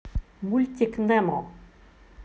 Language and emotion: Russian, positive